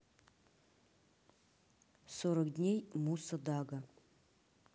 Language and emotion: Russian, neutral